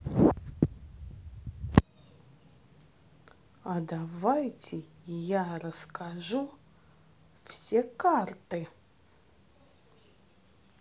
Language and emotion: Russian, positive